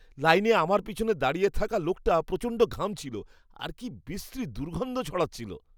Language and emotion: Bengali, disgusted